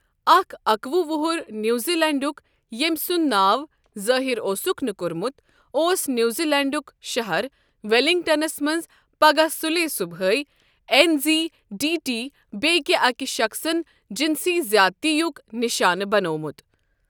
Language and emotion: Kashmiri, neutral